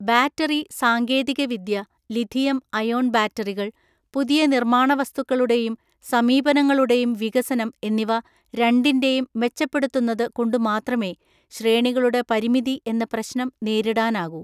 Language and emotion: Malayalam, neutral